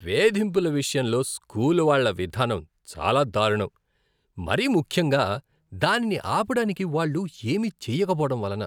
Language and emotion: Telugu, disgusted